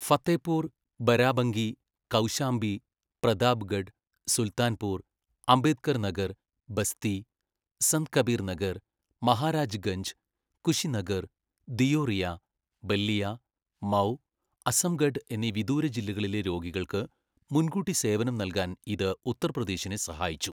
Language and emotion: Malayalam, neutral